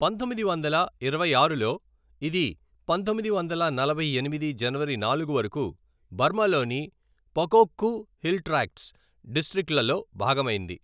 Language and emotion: Telugu, neutral